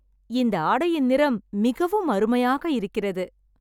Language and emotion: Tamil, happy